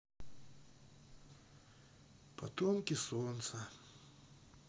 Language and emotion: Russian, sad